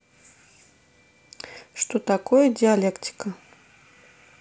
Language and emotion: Russian, neutral